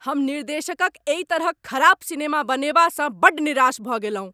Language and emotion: Maithili, angry